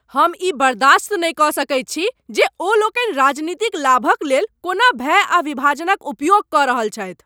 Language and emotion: Maithili, angry